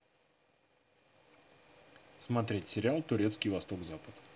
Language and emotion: Russian, neutral